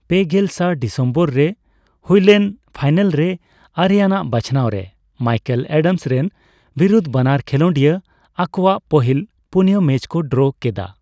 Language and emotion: Santali, neutral